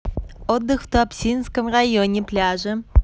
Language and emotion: Russian, positive